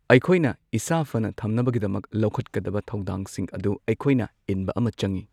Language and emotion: Manipuri, neutral